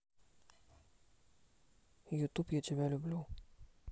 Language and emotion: Russian, neutral